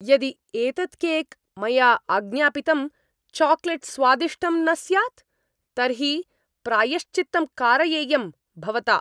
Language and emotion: Sanskrit, angry